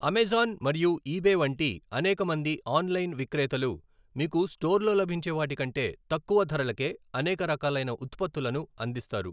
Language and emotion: Telugu, neutral